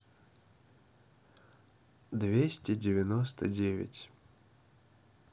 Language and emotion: Russian, neutral